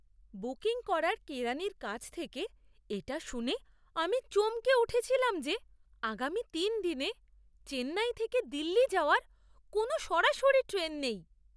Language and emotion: Bengali, surprised